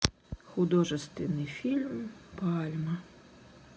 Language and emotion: Russian, sad